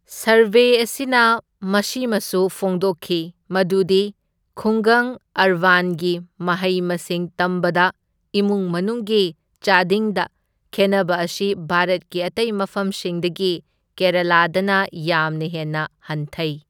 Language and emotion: Manipuri, neutral